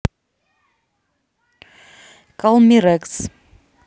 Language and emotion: Russian, neutral